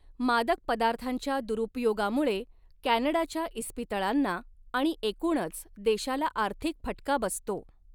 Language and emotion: Marathi, neutral